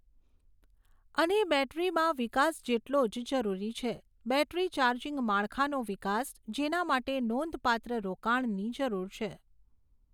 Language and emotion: Gujarati, neutral